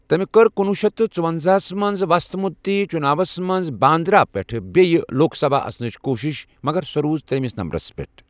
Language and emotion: Kashmiri, neutral